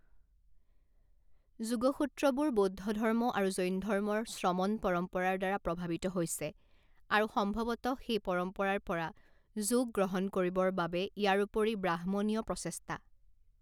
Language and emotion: Assamese, neutral